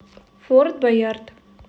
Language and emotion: Russian, neutral